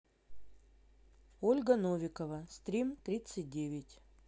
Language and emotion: Russian, neutral